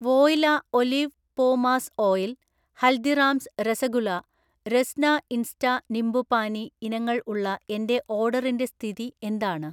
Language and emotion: Malayalam, neutral